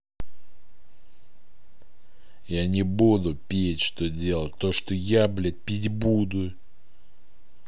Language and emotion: Russian, angry